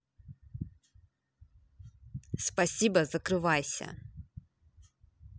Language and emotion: Russian, angry